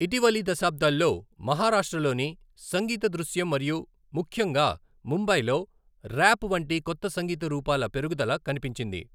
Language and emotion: Telugu, neutral